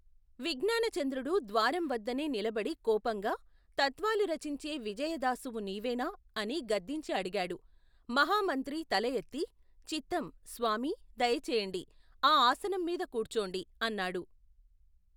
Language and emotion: Telugu, neutral